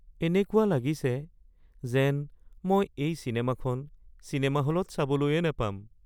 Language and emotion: Assamese, sad